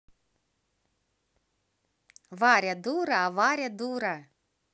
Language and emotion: Russian, positive